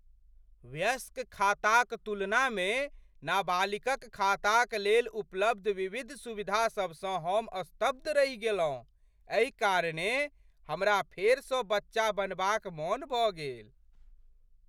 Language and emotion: Maithili, surprised